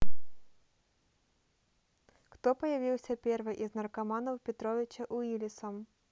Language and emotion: Russian, neutral